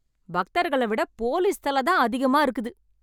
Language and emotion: Tamil, angry